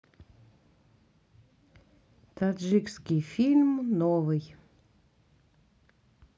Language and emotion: Russian, neutral